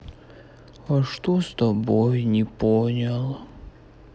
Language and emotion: Russian, sad